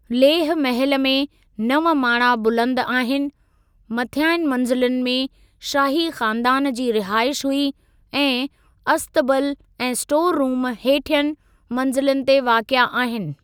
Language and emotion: Sindhi, neutral